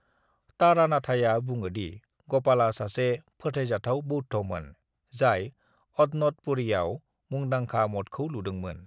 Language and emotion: Bodo, neutral